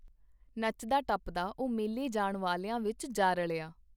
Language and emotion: Punjabi, neutral